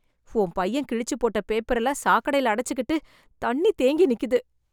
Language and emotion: Tamil, disgusted